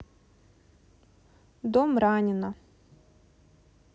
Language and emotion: Russian, neutral